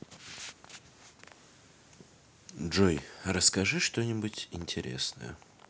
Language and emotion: Russian, neutral